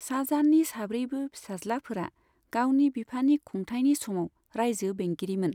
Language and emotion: Bodo, neutral